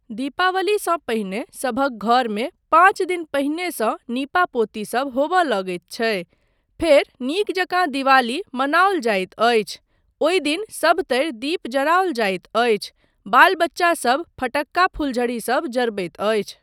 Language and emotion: Maithili, neutral